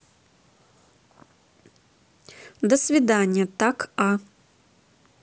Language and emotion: Russian, neutral